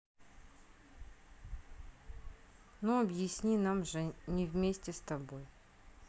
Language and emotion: Russian, neutral